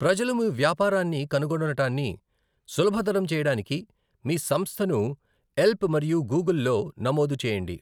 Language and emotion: Telugu, neutral